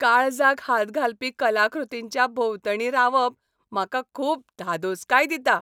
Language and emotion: Goan Konkani, happy